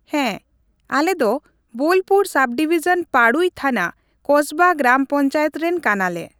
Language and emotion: Santali, neutral